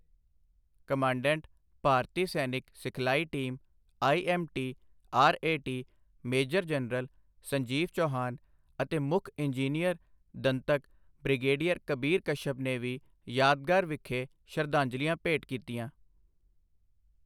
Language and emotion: Punjabi, neutral